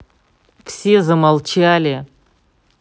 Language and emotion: Russian, angry